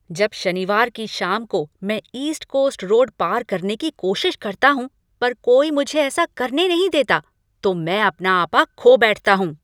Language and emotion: Hindi, angry